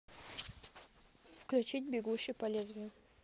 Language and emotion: Russian, neutral